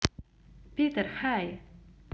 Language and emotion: Russian, positive